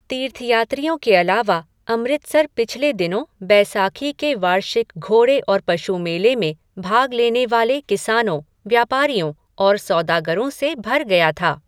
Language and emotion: Hindi, neutral